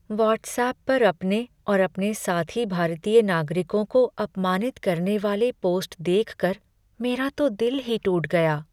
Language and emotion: Hindi, sad